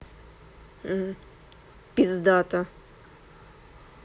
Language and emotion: Russian, neutral